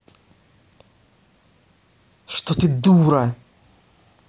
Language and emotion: Russian, angry